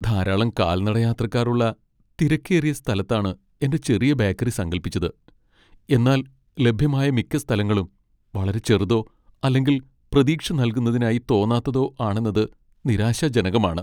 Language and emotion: Malayalam, sad